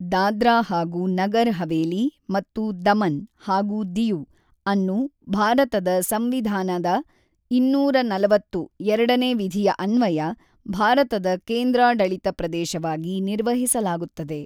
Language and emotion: Kannada, neutral